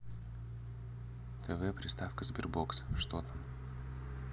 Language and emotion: Russian, neutral